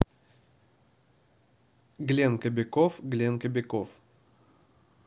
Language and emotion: Russian, neutral